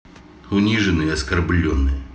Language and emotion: Russian, angry